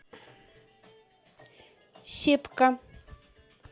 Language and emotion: Russian, neutral